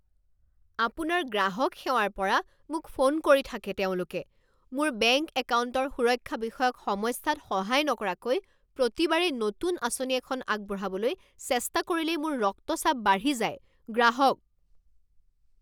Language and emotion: Assamese, angry